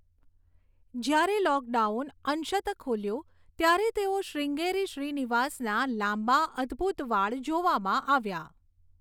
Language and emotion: Gujarati, neutral